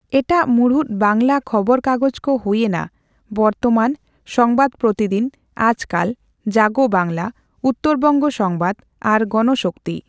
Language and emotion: Santali, neutral